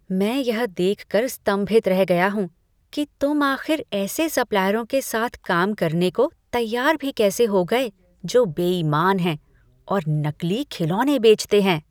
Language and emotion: Hindi, disgusted